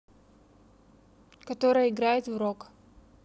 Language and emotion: Russian, neutral